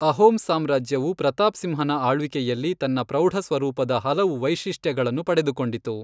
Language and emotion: Kannada, neutral